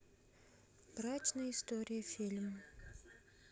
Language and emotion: Russian, neutral